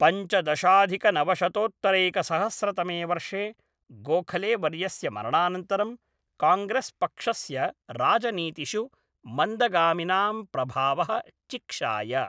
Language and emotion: Sanskrit, neutral